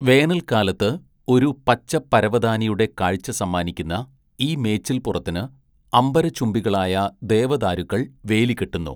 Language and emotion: Malayalam, neutral